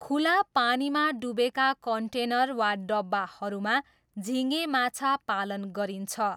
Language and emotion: Nepali, neutral